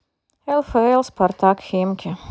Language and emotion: Russian, neutral